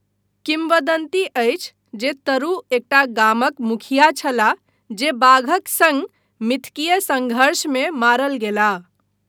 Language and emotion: Maithili, neutral